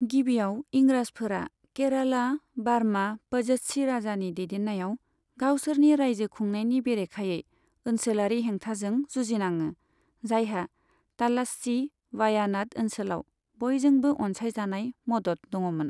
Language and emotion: Bodo, neutral